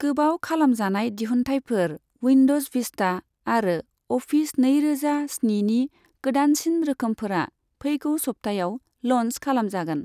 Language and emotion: Bodo, neutral